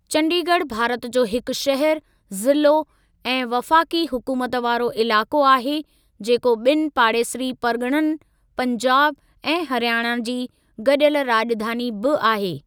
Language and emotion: Sindhi, neutral